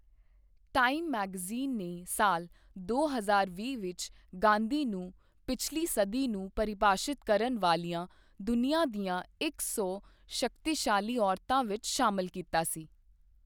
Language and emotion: Punjabi, neutral